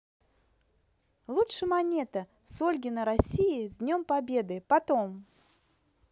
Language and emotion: Russian, positive